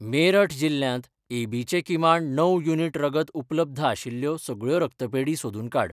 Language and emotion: Goan Konkani, neutral